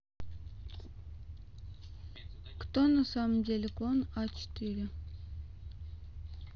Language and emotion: Russian, neutral